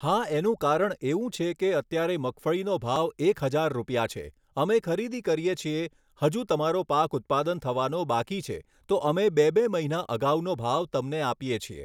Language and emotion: Gujarati, neutral